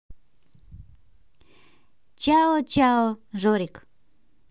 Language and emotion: Russian, positive